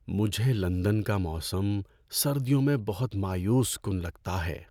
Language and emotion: Urdu, sad